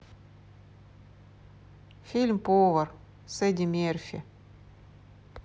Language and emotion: Russian, neutral